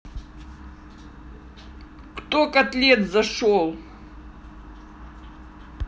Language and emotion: Russian, angry